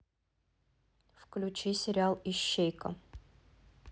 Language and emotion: Russian, neutral